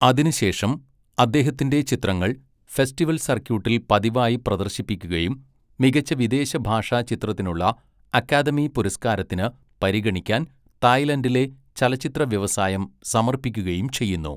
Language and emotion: Malayalam, neutral